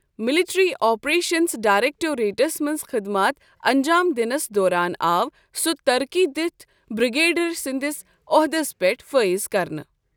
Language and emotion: Kashmiri, neutral